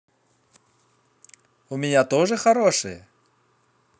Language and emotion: Russian, positive